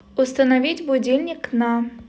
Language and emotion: Russian, neutral